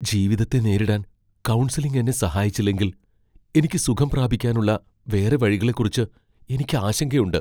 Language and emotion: Malayalam, fearful